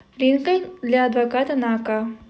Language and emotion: Russian, neutral